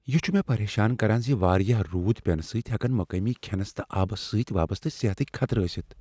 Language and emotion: Kashmiri, fearful